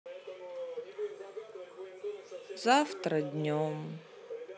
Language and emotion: Russian, sad